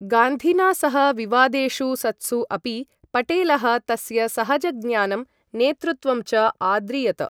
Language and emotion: Sanskrit, neutral